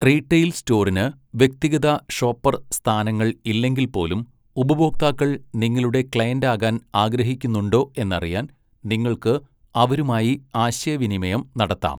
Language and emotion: Malayalam, neutral